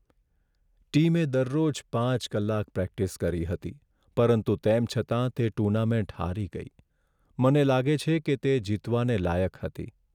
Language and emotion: Gujarati, sad